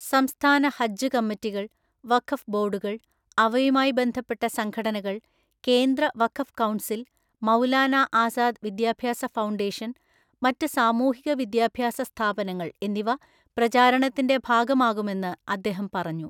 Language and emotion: Malayalam, neutral